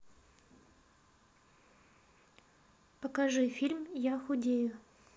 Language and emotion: Russian, neutral